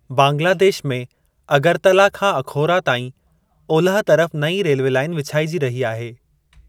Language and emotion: Sindhi, neutral